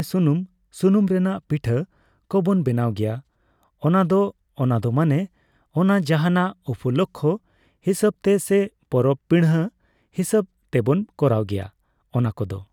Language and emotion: Santali, neutral